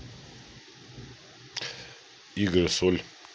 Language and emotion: Russian, neutral